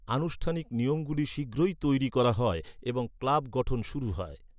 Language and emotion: Bengali, neutral